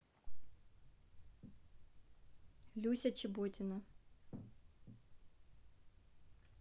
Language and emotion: Russian, neutral